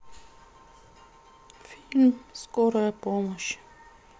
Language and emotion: Russian, sad